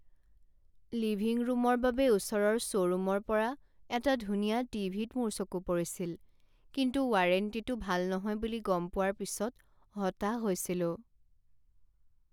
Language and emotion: Assamese, sad